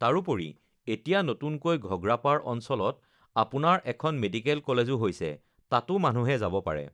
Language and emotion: Assamese, neutral